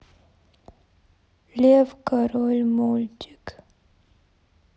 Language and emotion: Russian, sad